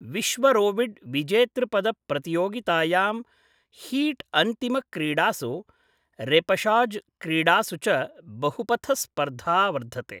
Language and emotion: Sanskrit, neutral